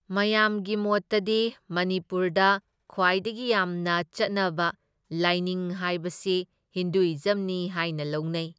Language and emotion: Manipuri, neutral